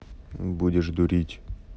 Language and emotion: Russian, neutral